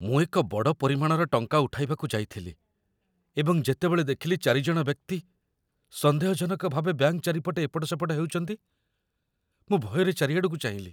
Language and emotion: Odia, fearful